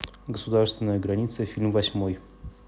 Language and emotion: Russian, neutral